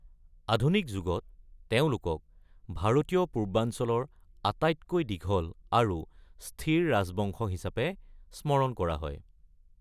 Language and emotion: Assamese, neutral